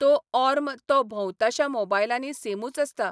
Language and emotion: Goan Konkani, neutral